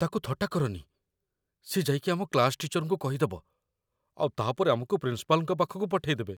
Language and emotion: Odia, fearful